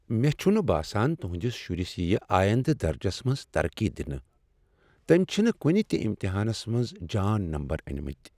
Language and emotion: Kashmiri, sad